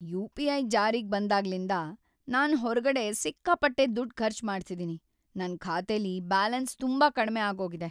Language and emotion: Kannada, sad